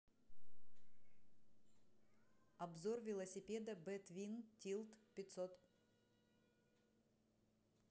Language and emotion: Russian, neutral